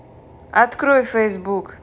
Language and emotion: Russian, neutral